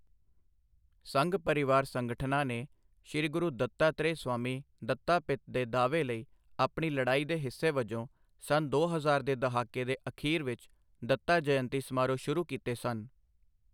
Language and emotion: Punjabi, neutral